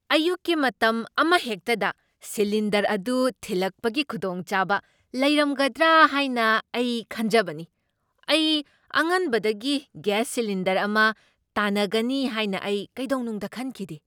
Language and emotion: Manipuri, surprised